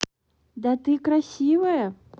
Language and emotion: Russian, positive